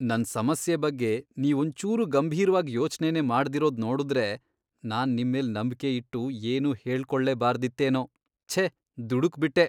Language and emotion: Kannada, disgusted